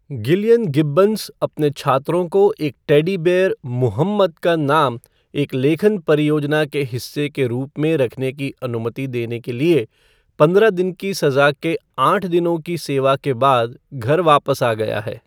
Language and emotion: Hindi, neutral